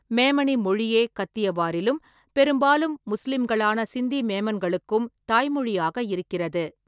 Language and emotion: Tamil, neutral